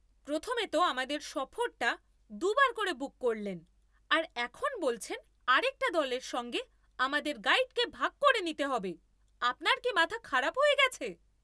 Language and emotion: Bengali, angry